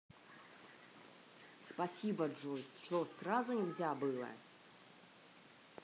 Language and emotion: Russian, angry